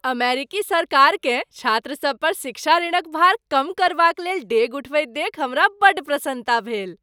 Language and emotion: Maithili, happy